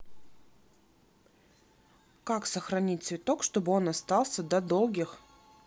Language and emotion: Russian, neutral